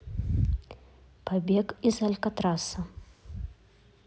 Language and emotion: Russian, neutral